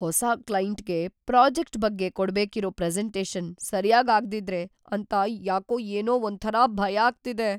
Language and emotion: Kannada, fearful